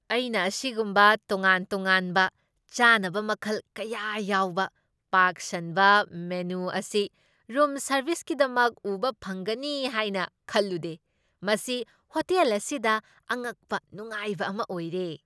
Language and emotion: Manipuri, surprised